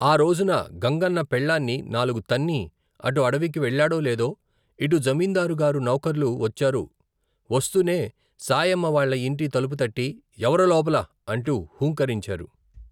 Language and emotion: Telugu, neutral